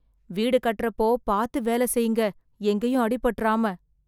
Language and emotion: Tamil, fearful